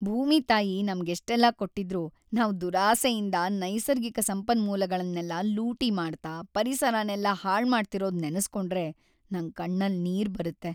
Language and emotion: Kannada, sad